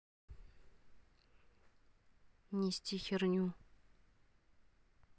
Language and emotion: Russian, neutral